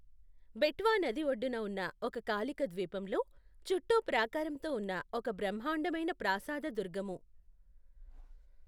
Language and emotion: Telugu, neutral